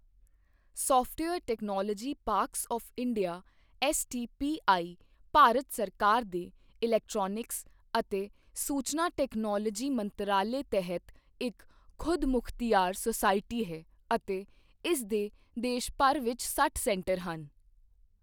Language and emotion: Punjabi, neutral